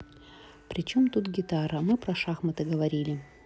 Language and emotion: Russian, neutral